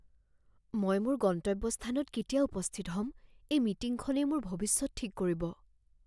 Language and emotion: Assamese, fearful